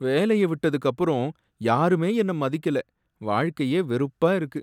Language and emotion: Tamil, sad